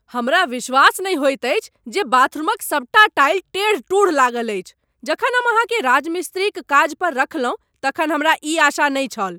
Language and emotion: Maithili, angry